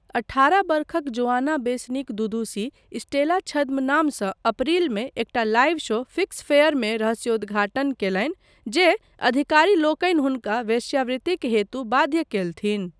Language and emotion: Maithili, neutral